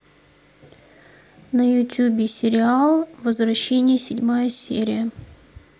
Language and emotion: Russian, neutral